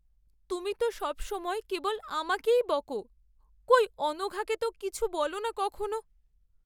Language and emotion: Bengali, sad